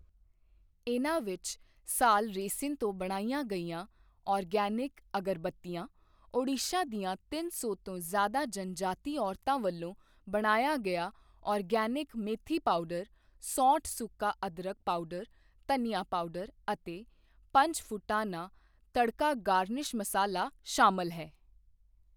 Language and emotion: Punjabi, neutral